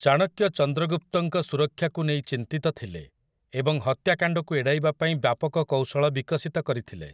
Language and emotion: Odia, neutral